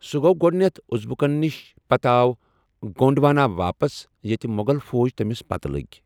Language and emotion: Kashmiri, neutral